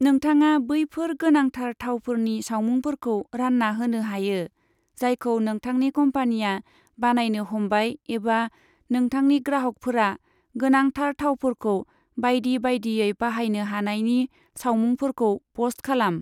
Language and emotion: Bodo, neutral